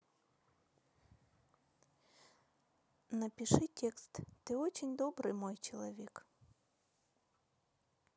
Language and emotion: Russian, neutral